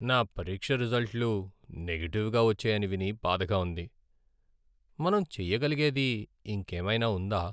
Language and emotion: Telugu, sad